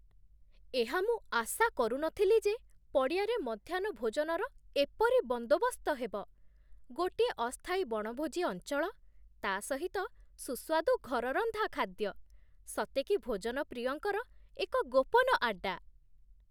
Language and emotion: Odia, surprised